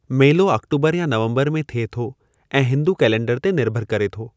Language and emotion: Sindhi, neutral